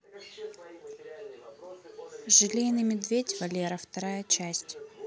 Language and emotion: Russian, neutral